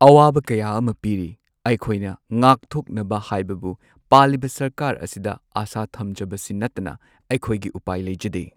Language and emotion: Manipuri, neutral